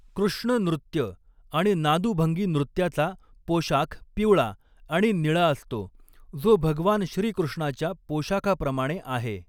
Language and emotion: Marathi, neutral